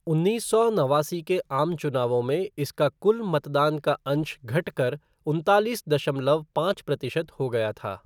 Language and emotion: Hindi, neutral